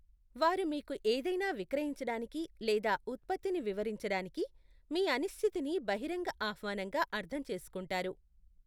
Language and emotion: Telugu, neutral